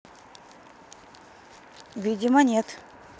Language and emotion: Russian, neutral